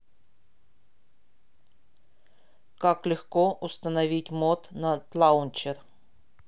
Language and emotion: Russian, neutral